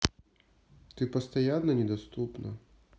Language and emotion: Russian, neutral